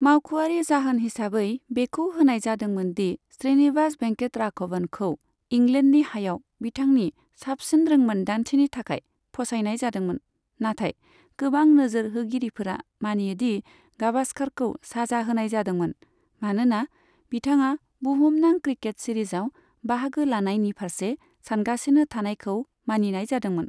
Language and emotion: Bodo, neutral